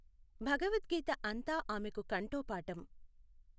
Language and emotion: Telugu, neutral